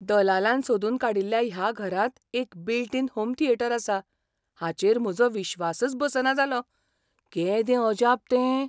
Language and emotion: Goan Konkani, surprised